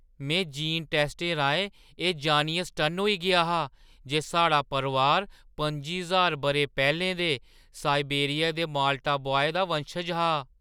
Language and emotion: Dogri, surprised